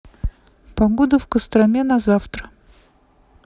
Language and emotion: Russian, neutral